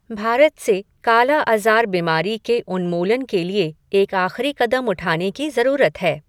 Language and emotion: Hindi, neutral